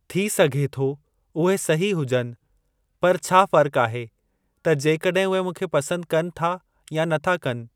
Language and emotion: Sindhi, neutral